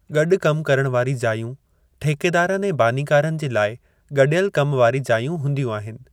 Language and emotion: Sindhi, neutral